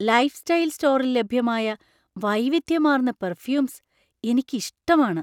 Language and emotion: Malayalam, surprised